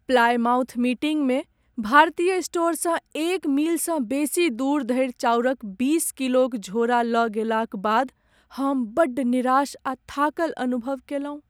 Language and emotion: Maithili, sad